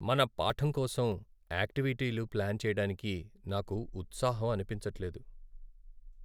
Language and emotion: Telugu, sad